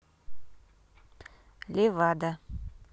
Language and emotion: Russian, neutral